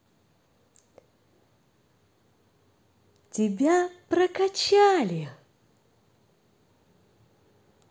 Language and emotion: Russian, positive